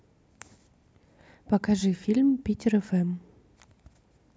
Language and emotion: Russian, neutral